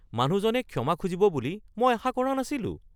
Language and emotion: Assamese, surprised